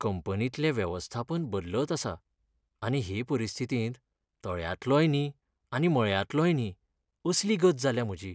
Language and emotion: Goan Konkani, sad